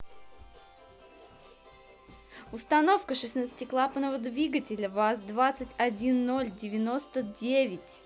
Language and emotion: Russian, positive